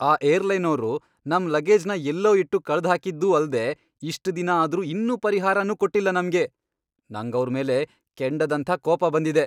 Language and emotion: Kannada, angry